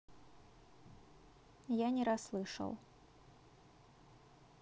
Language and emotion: Russian, neutral